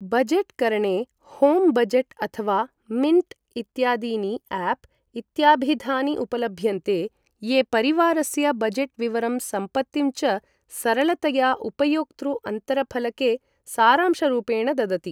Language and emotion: Sanskrit, neutral